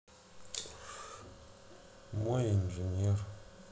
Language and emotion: Russian, sad